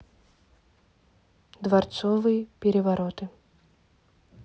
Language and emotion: Russian, neutral